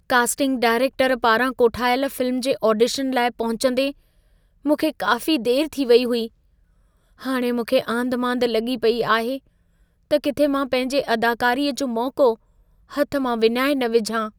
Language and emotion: Sindhi, fearful